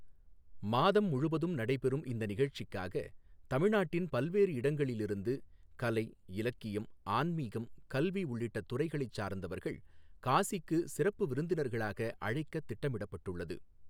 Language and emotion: Tamil, neutral